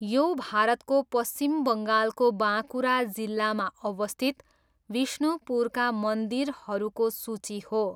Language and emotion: Nepali, neutral